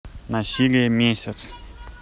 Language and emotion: Russian, neutral